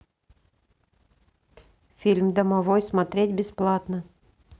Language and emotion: Russian, neutral